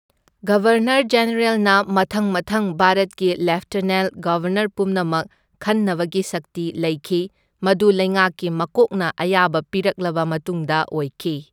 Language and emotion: Manipuri, neutral